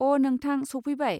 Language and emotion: Bodo, neutral